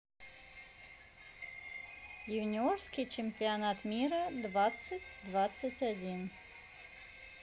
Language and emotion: Russian, neutral